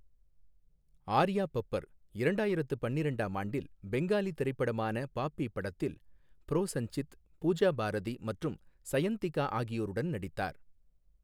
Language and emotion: Tamil, neutral